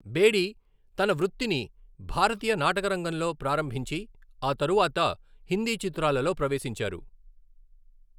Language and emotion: Telugu, neutral